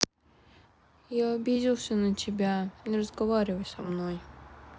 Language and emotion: Russian, sad